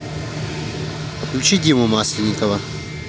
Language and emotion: Russian, neutral